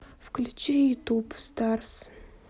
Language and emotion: Russian, neutral